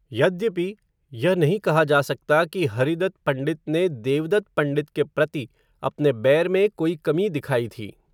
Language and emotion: Hindi, neutral